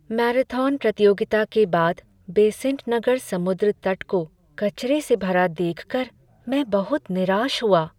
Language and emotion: Hindi, sad